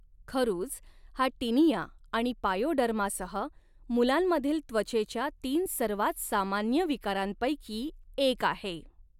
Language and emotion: Marathi, neutral